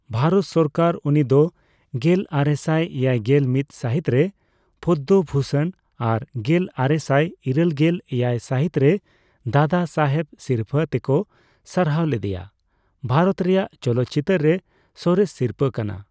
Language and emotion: Santali, neutral